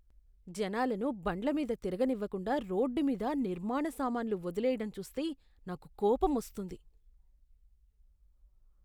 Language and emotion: Telugu, disgusted